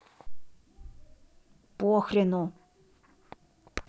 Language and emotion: Russian, angry